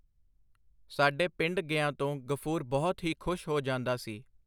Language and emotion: Punjabi, neutral